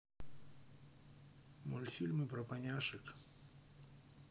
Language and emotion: Russian, neutral